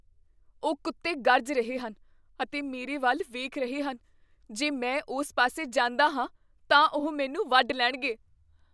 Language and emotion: Punjabi, fearful